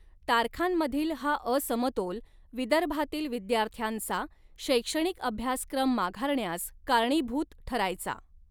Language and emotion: Marathi, neutral